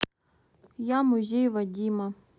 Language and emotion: Russian, neutral